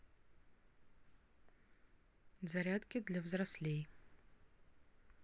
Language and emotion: Russian, neutral